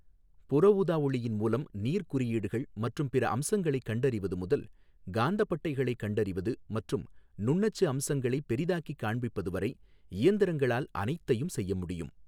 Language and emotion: Tamil, neutral